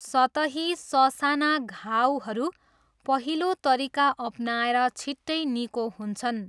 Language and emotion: Nepali, neutral